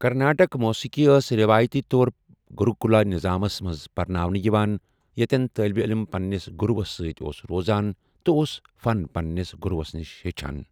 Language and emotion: Kashmiri, neutral